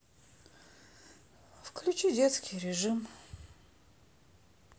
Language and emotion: Russian, sad